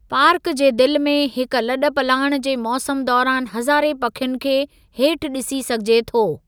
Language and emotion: Sindhi, neutral